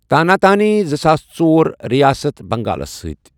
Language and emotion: Kashmiri, neutral